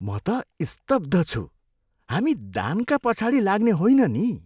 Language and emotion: Nepali, disgusted